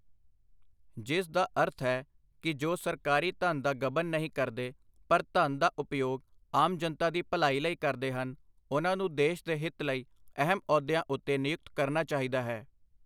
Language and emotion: Punjabi, neutral